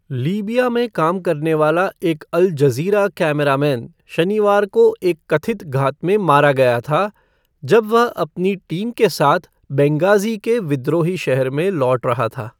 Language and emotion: Hindi, neutral